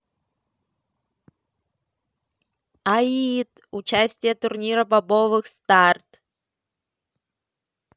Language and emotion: Russian, positive